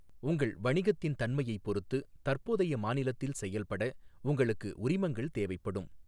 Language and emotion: Tamil, neutral